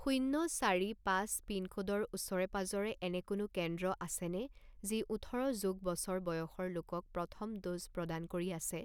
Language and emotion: Assamese, neutral